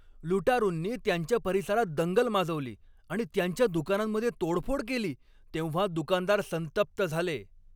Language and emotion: Marathi, angry